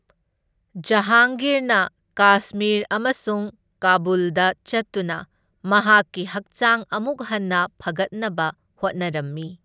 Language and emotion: Manipuri, neutral